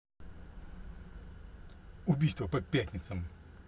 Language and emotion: Russian, angry